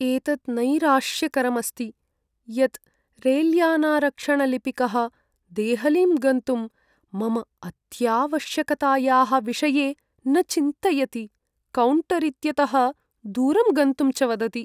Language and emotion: Sanskrit, sad